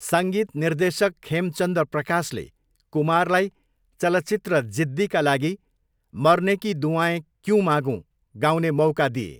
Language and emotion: Nepali, neutral